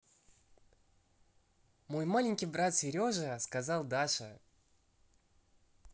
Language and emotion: Russian, positive